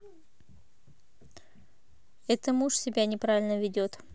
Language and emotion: Russian, neutral